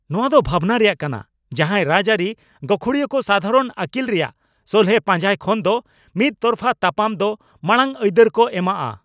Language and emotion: Santali, angry